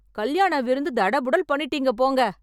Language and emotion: Tamil, happy